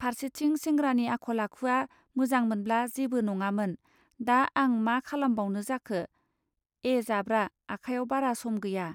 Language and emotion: Bodo, neutral